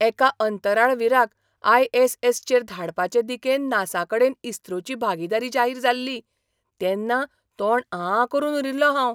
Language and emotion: Goan Konkani, surprised